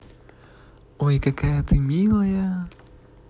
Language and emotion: Russian, positive